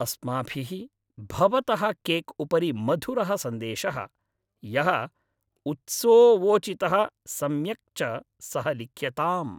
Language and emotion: Sanskrit, happy